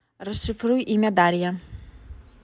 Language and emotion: Russian, neutral